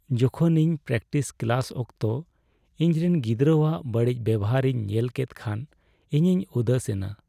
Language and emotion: Santali, sad